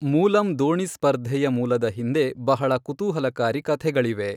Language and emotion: Kannada, neutral